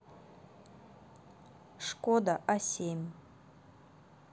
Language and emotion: Russian, neutral